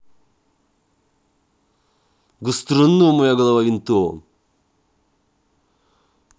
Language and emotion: Russian, angry